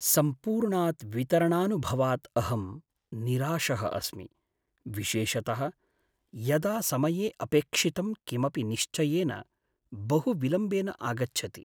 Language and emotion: Sanskrit, sad